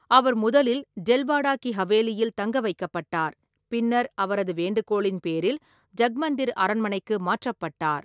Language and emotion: Tamil, neutral